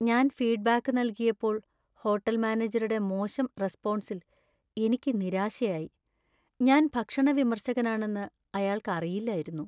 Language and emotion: Malayalam, sad